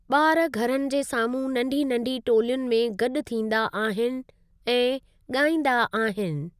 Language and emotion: Sindhi, neutral